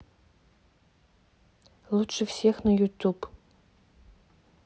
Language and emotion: Russian, neutral